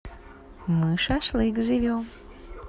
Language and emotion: Russian, positive